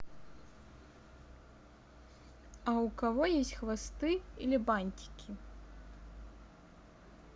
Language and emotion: Russian, neutral